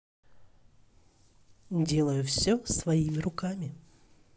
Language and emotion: Russian, neutral